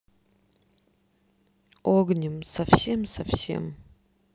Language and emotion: Russian, sad